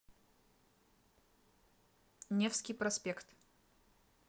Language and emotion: Russian, neutral